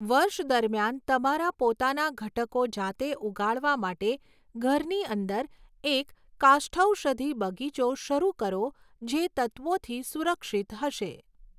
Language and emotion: Gujarati, neutral